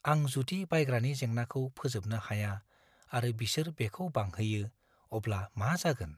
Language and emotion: Bodo, fearful